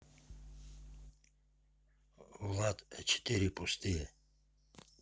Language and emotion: Russian, neutral